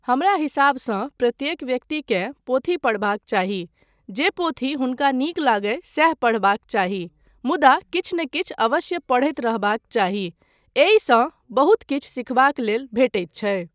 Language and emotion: Maithili, neutral